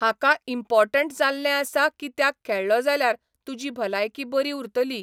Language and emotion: Goan Konkani, neutral